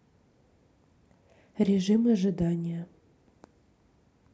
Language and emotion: Russian, neutral